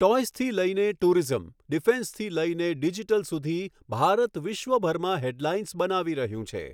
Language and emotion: Gujarati, neutral